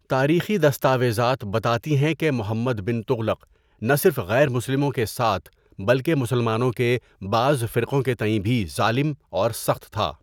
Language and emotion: Urdu, neutral